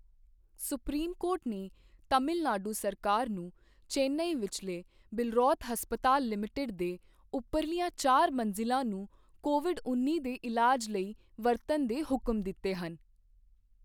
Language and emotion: Punjabi, neutral